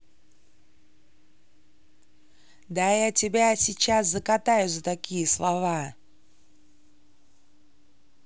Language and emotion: Russian, angry